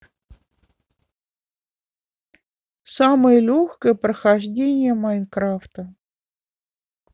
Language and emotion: Russian, neutral